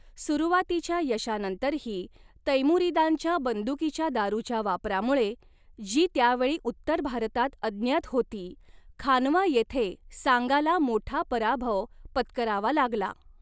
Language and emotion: Marathi, neutral